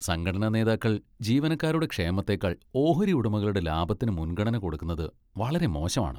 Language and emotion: Malayalam, disgusted